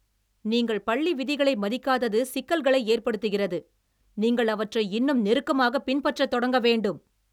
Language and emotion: Tamil, angry